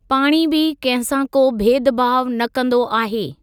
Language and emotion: Sindhi, neutral